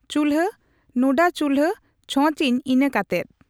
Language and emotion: Santali, neutral